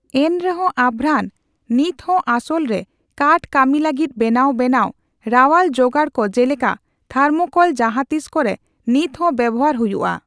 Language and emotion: Santali, neutral